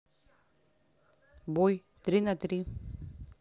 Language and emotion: Russian, neutral